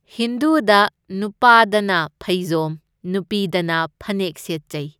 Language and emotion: Manipuri, neutral